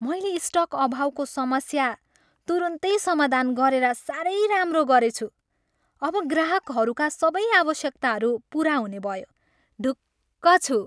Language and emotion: Nepali, happy